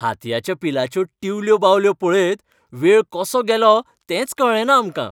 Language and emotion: Goan Konkani, happy